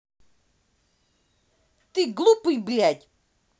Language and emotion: Russian, angry